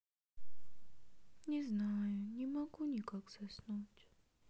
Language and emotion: Russian, sad